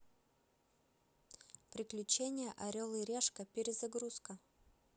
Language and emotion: Russian, neutral